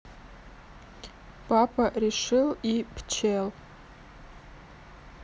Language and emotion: Russian, neutral